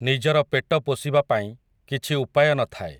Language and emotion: Odia, neutral